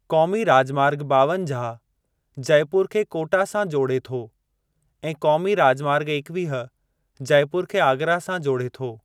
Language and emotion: Sindhi, neutral